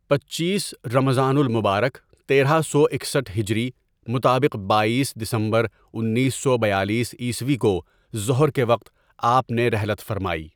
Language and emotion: Urdu, neutral